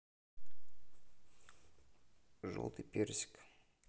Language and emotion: Russian, neutral